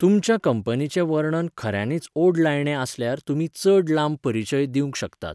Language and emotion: Goan Konkani, neutral